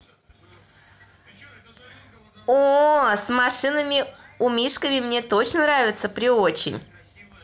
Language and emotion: Russian, positive